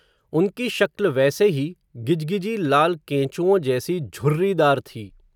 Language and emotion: Hindi, neutral